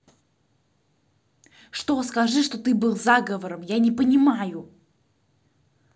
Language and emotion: Russian, angry